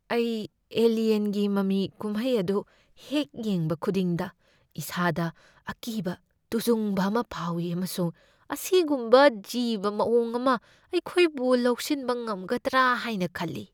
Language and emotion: Manipuri, fearful